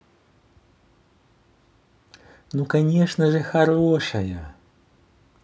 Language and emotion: Russian, positive